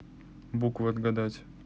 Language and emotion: Russian, neutral